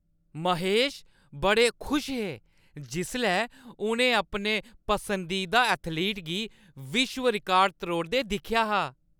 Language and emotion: Dogri, happy